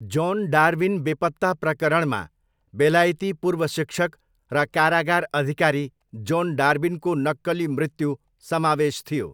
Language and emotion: Nepali, neutral